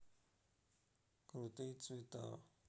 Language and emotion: Russian, neutral